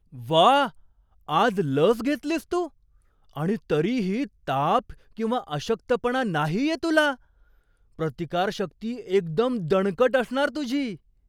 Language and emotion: Marathi, surprised